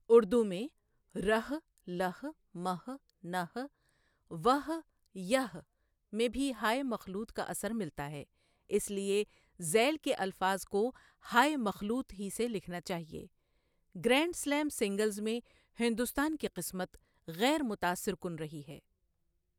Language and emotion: Urdu, neutral